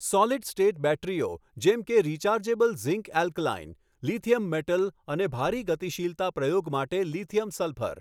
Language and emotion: Gujarati, neutral